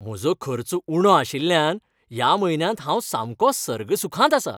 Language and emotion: Goan Konkani, happy